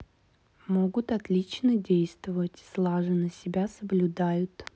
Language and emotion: Russian, neutral